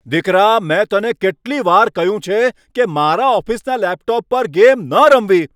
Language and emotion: Gujarati, angry